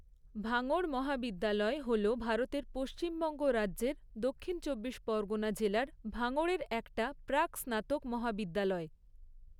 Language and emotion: Bengali, neutral